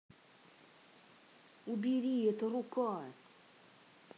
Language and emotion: Russian, angry